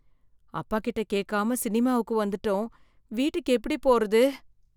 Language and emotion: Tamil, fearful